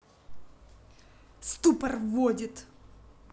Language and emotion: Russian, angry